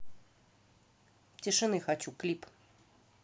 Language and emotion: Russian, neutral